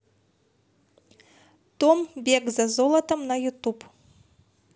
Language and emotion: Russian, positive